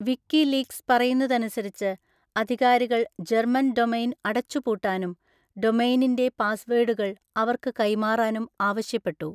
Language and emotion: Malayalam, neutral